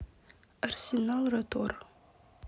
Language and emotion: Russian, neutral